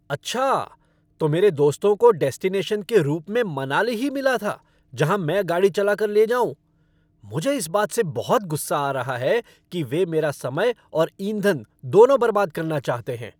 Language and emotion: Hindi, angry